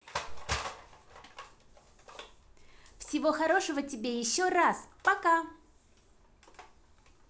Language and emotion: Russian, positive